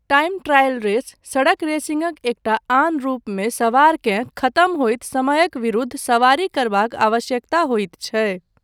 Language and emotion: Maithili, neutral